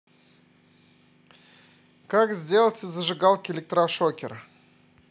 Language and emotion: Russian, positive